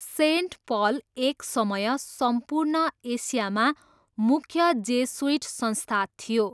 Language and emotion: Nepali, neutral